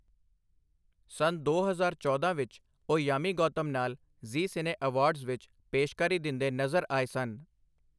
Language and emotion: Punjabi, neutral